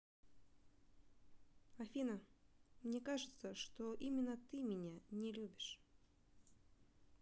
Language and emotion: Russian, neutral